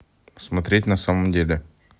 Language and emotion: Russian, neutral